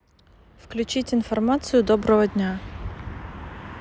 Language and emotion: Russian, neutral